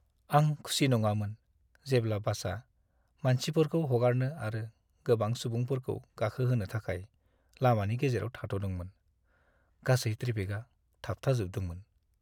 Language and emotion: Bodo, sad